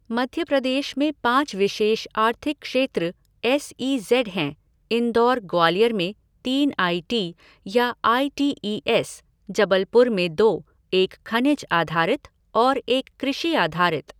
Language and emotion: Hindi, neutral